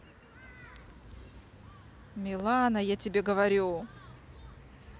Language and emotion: Russian, angry